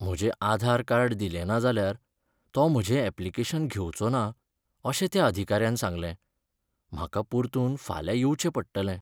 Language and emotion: Goan Konkani, sad